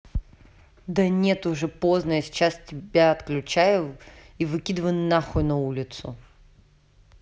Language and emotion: Russian, angry